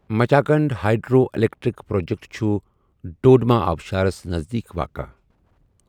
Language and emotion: Kashmiri, neutral